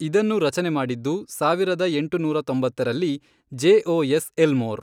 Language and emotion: Kannada, neutral